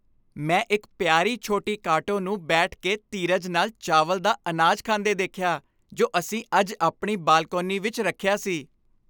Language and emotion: Punjabi, happy